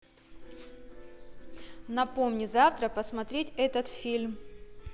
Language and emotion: Russian, positive